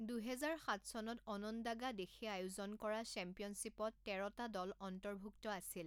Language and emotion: Assamese, neutral